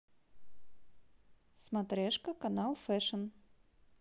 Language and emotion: Russian, neutral